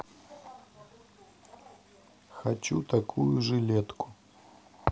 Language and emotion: Russian, neutral